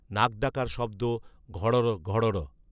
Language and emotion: Bengali, neutral